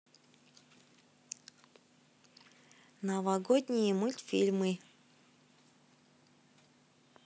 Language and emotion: Russian, neutral